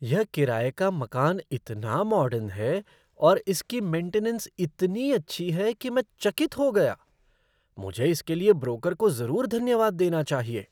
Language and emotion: Hindi, surprised